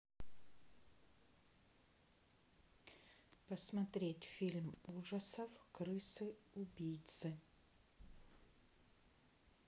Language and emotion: Russian, neutral